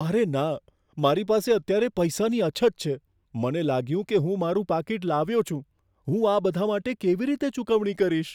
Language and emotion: Gujarati, fearful